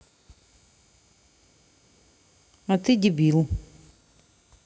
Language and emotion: Russian, neutral